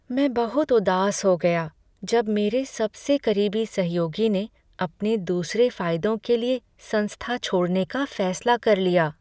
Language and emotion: Hindi, sad